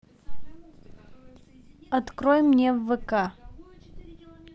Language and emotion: Russian, neutral